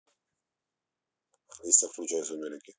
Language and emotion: Russian, neutral